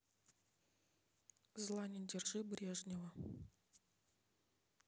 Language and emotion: Russian, neutral